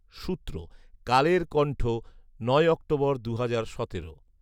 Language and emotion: Bengali, neutral